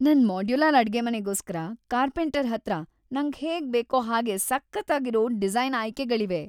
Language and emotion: Kannada, happy